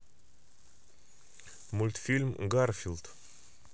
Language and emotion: Russian, neutral